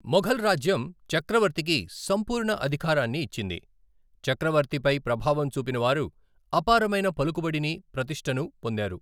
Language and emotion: Telugu, neutral